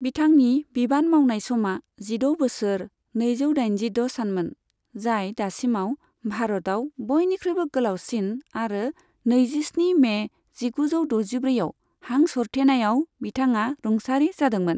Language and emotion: Bodo, neutral